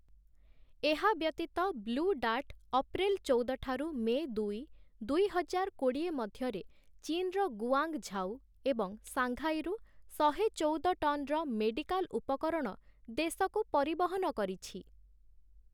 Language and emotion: Odia, neutral